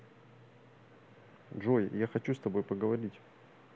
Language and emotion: Russian, neutral